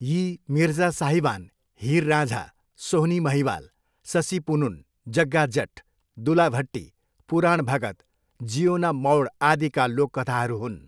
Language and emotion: Nepali, neutral